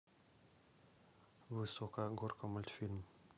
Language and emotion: Russian, neutral